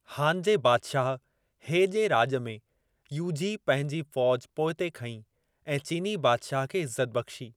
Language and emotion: Sindhi, neutral